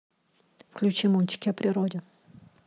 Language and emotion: Russian, neutral